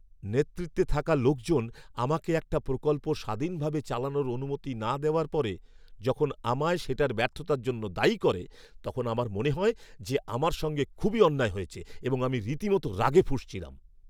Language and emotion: Bengali, angry